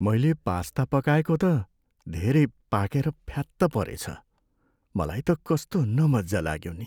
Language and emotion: Nepali, sad